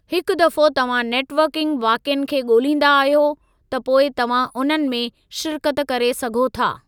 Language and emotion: Sindhi, neutral